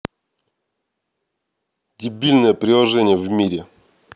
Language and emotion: Russian, angry